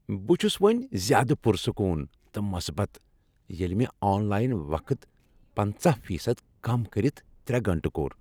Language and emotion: Kashmiri, happy